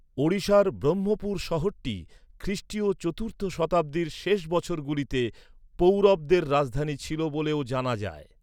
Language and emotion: Bengali, neutral